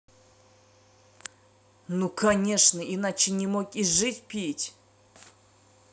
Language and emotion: Russian, angry